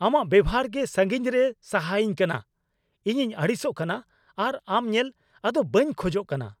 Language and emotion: Santali, angry